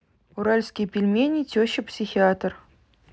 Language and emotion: Russian, neutral